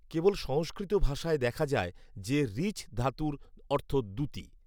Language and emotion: Bengali, neutral